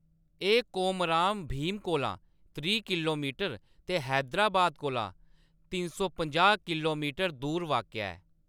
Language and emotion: Dogri, neutral